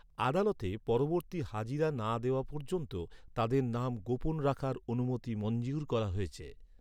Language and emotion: Bengali, neutral